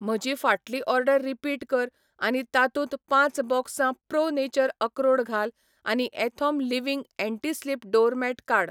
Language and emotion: Goan Konkani, neutral